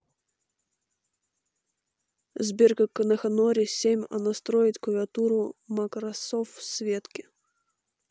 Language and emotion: Russian, neutral